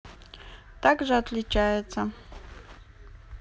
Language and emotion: Russian, neutral